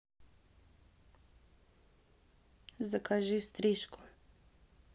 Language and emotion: Russian, neutral